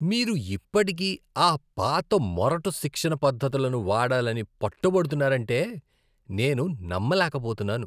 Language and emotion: Telugu, disgusted